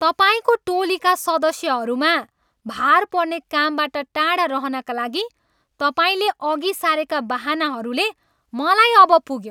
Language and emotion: Nepali, angry